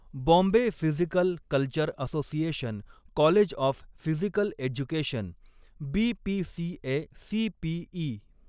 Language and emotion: Marathi, neutral